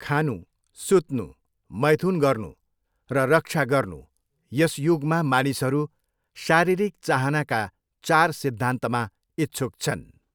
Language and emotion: Nepali, neutral